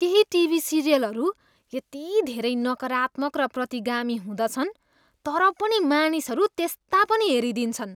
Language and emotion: Nepali, disgusted